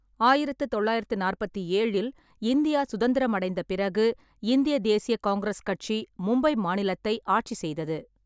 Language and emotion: Tamil, neutral